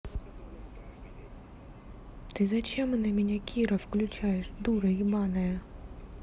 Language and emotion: Russian, angry